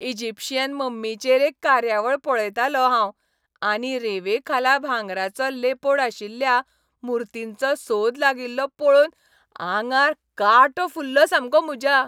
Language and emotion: Goan Konkani, happy